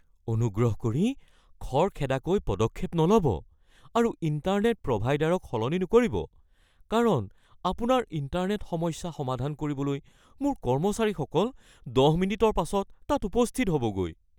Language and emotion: Assamese, fearful